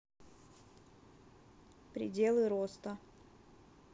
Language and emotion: Russian, neutral